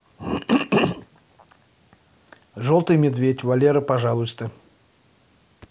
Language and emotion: Russian, neutral